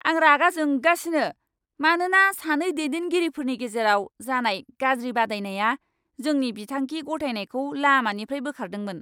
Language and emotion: Bodo, angry